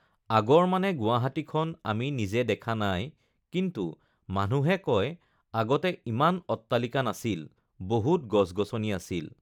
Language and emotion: Assamese, neutral